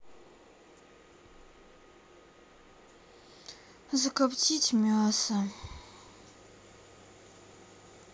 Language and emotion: Russian, sad